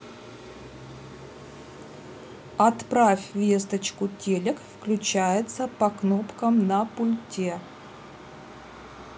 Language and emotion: Russian, neutral